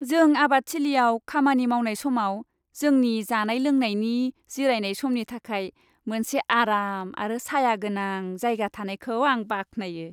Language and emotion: Bodo, happy